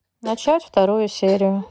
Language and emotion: Russian, neutral